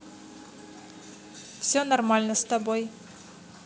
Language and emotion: Russian, neutral